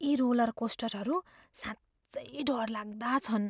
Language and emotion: Nepali, fearful